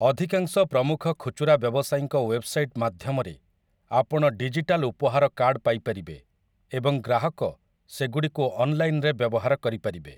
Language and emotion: Odia, neutral